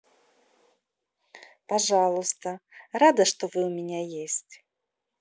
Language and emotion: Russian, positive